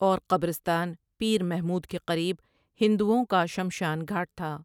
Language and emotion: Urdu, neutral